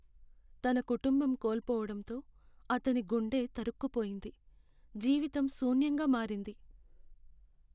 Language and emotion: Telugu, sad